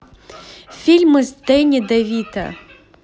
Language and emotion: Russian, positive